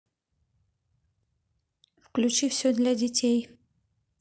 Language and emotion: Russian, neutral